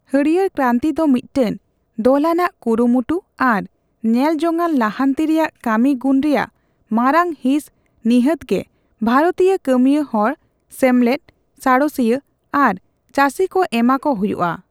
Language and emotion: Santali, neutral